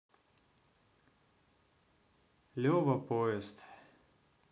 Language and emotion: Russian, neutral